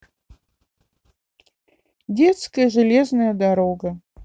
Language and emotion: Russian, sad